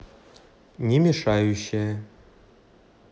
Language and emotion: Russian, neutral